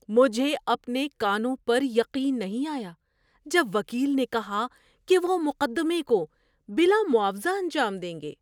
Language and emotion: Urdu, surprised